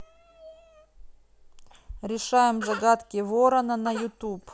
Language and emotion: Russian, neutral